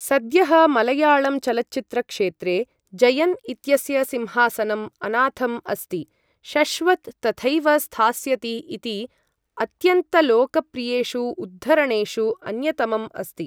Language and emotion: Sanskrit, neutral